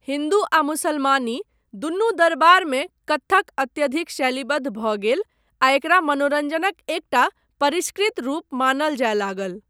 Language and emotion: Maithili, neutral